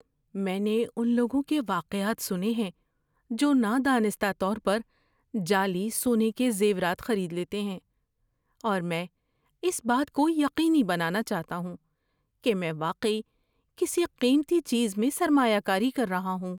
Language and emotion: Urdu, fearful